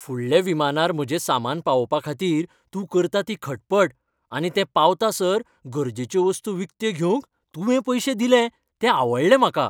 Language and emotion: Goan Konkani, happy